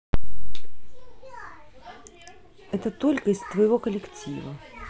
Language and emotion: Russian, neutral